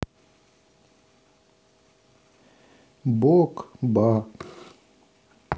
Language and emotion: Russian, sad